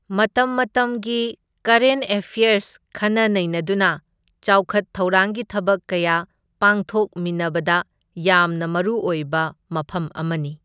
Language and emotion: Manipuri, neutral